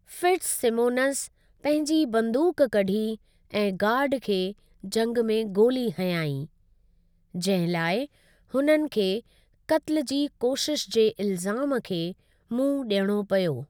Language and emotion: Sindhi, neutral